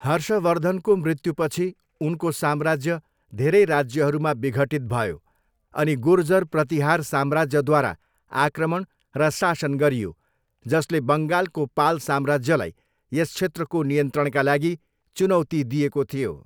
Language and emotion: Nepali, neutral